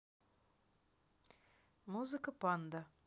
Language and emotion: Russian, neutral